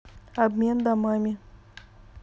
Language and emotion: Russian, neutral